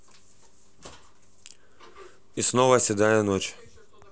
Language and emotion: Russian, neutral